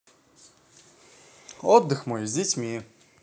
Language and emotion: Russian, positive